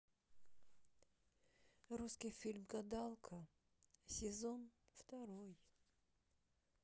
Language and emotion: Russian, sad